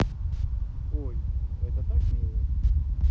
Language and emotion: Russian, positive